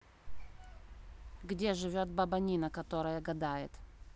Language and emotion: Russian, neutral